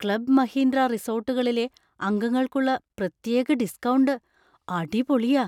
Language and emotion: Malayalam, surprised